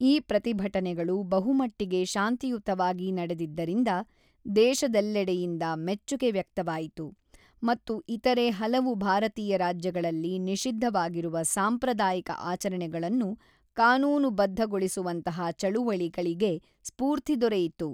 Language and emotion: Kannada, neutral